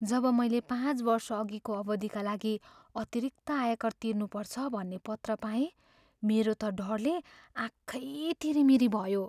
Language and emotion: Nepali, fearful